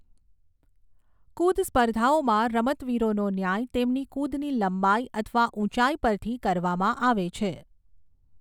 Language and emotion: Gujarati, neutral